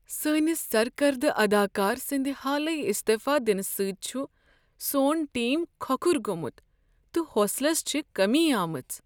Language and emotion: Kashmiri, sad